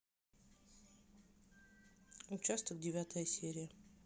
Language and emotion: Russian, neutral